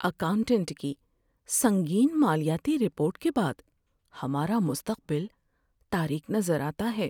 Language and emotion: Urdu, sad